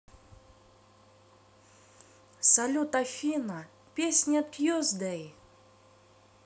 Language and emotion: Russian, positive